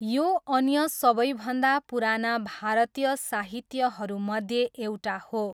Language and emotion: Nepali, neutral